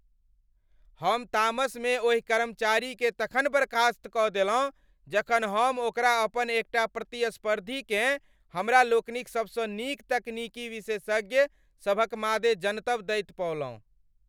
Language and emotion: Maithili, angry